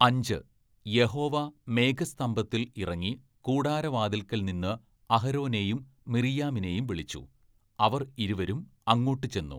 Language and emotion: Malayalam, neutral